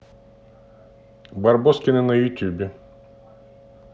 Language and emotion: Russian, neutral